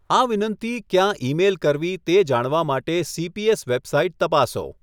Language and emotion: Gujarati, neutral